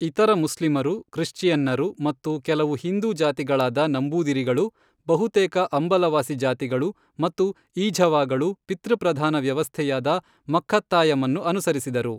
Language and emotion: Kannada, neutral